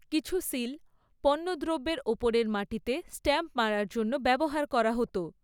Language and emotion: Bengali, neutral